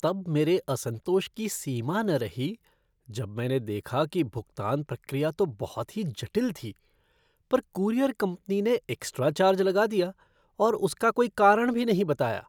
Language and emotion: Hindi, disgusted